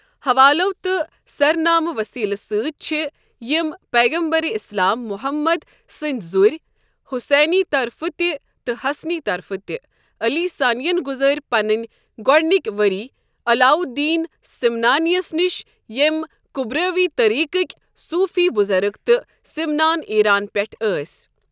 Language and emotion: Kashmiri, neutral